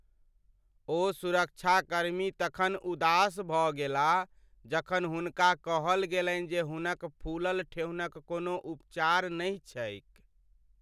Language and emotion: Maithili, sad